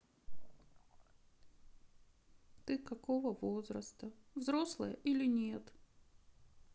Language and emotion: Russian, sad